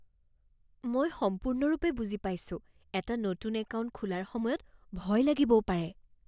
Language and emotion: Assamese, fearful